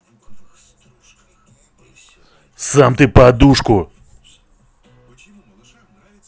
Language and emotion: Russian, angry